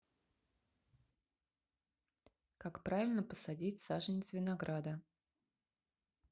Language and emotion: Russian, neutral